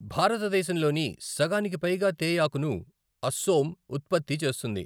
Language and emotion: Telugu, neutral